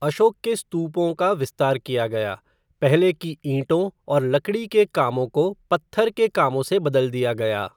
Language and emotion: Hindi, neutral